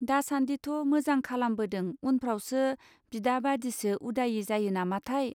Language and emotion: Bodo, neutral